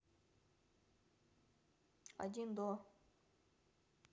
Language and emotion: Russian, neutral